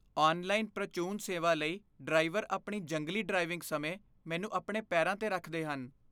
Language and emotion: Punjabi, fearful